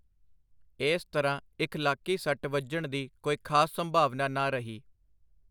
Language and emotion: Punjabi, neutral